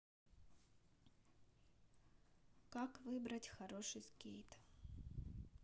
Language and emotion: Russian, neutral